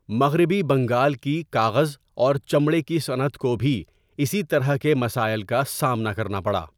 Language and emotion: Urdu, neutral